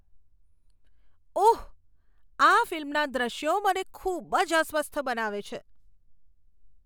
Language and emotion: Gujarati, disgusted